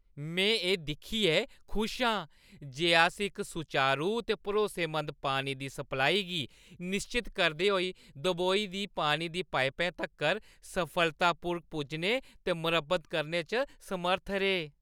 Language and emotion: Dogri, happy